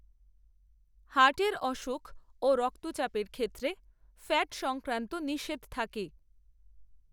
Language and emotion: Bengali, neutral